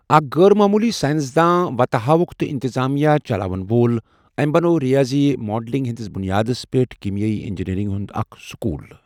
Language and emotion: Kashmiri, neutral